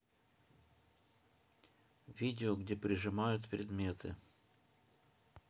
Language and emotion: Russian, neutral